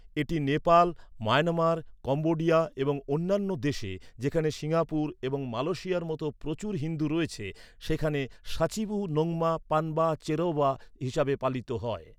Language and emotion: Bengali, neutral